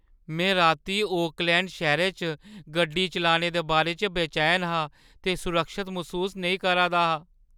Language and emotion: Dogri, fearful